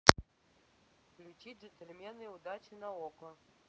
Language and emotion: Russian, neutral